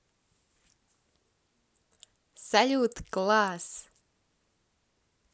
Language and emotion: Russian, positive